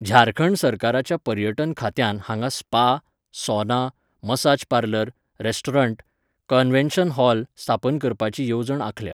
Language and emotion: Goan Konkani, neutral